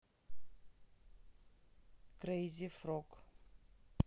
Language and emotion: Russian, neutral